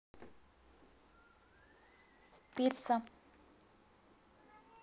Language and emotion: Russian, neutral